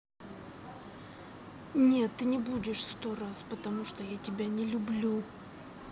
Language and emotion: Russian, angry